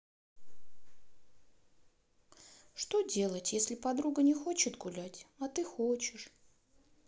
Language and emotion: Russian, sad